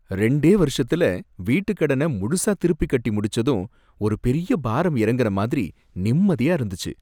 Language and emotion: Tamil, happy